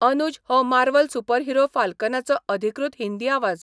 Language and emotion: Goan Konkani, neutral